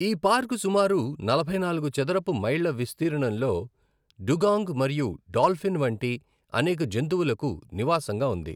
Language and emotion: Telugu, neutral